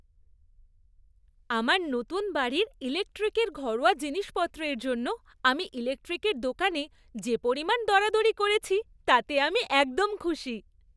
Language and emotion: Bengali, happy